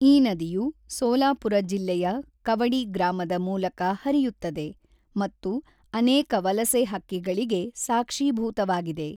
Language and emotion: Kannada, neutral